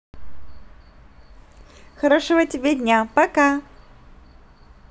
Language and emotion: Russian, positive